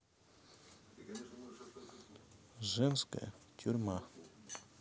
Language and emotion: Russian, neutral